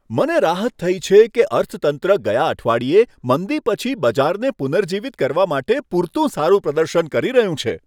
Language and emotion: Gujarati, happy